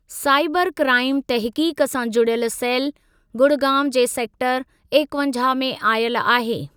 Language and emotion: Sindhi, neutral